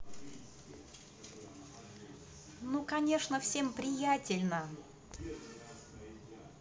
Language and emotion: Russian, positive